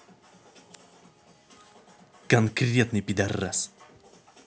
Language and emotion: Russian, angry